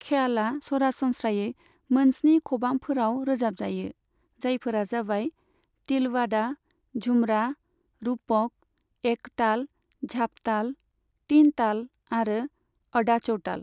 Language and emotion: Bodo, neutral